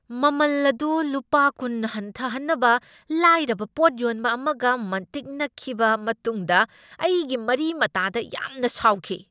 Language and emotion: Manipuri, angry